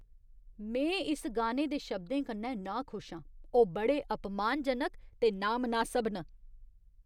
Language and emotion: Dogri, disgusted